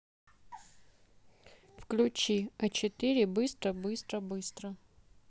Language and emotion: Russian, neutral